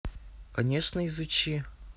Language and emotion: Russian, neutral